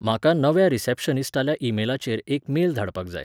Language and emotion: Goan Konkani, neutral